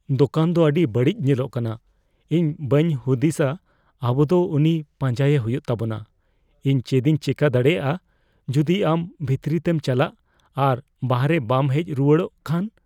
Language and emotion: Santali, fearful